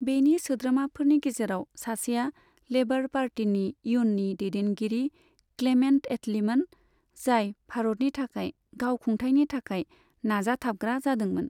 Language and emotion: Bodo, neutral